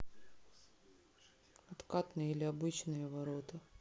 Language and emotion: Russian, sad